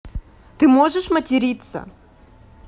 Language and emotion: Russian, neutral